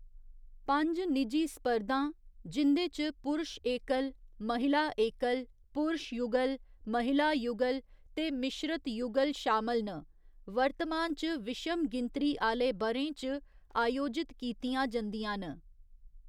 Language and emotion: Dogri, neutral